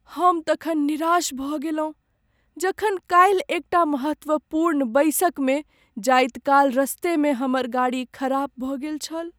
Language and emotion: Maithili, sad